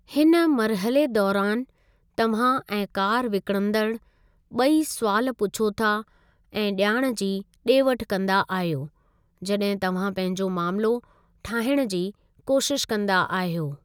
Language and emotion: Sindhi, neutral